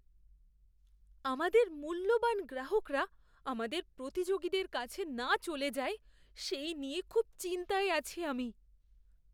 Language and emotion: Bengali, fearful